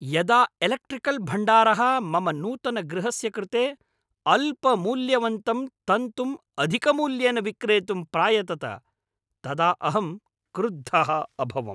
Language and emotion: Sanskrit, angry